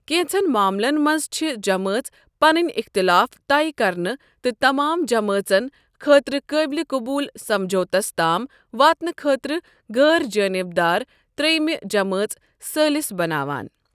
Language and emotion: Kashmiri, neutral